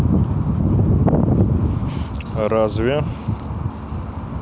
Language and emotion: Russian, neutral